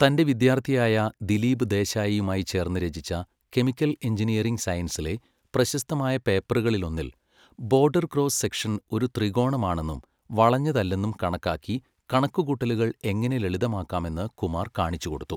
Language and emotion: Malayalam, neutral